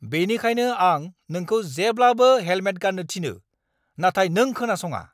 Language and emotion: Bodo, angry